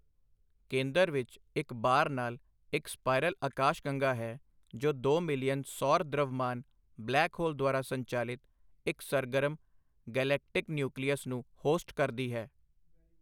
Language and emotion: Punjabi, neutral